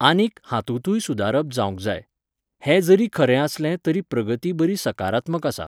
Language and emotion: Goan Konkani, neutral